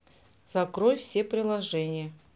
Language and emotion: Russian, neutral